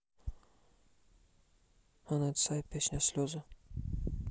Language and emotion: Russian, neutral